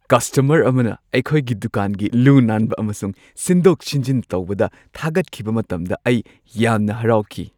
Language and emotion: Manipuri, happy